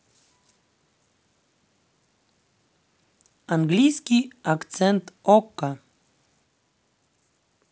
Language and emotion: Russian, neutral